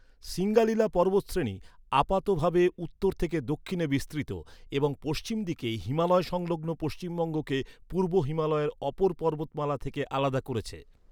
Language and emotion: Bengali, neutral